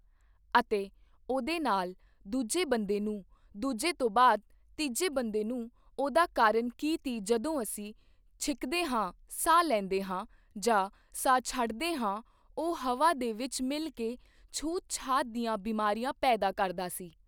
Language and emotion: Punjabi, neutral